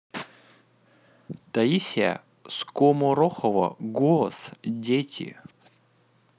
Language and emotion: Russian, neutral